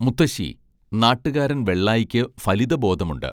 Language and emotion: Malayalam, neutral